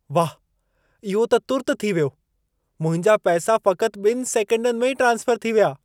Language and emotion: Sindhi, surprised